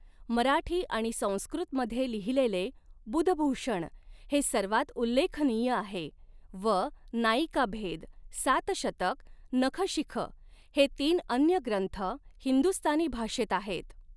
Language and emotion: Marathi, neutral